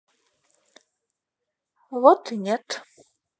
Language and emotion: Russian, neutral